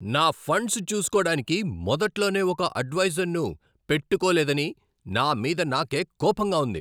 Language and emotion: Telugu, angry